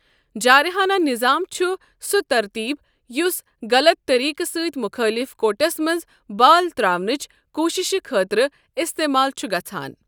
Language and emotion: Kashmiri, neutral